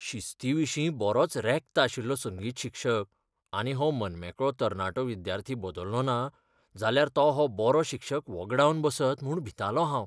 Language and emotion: Goan Konkani, fearful